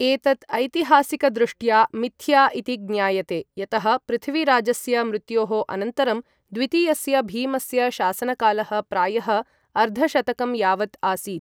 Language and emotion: Sanskrit, neutral